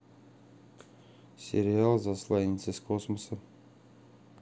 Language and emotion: Russian, neutral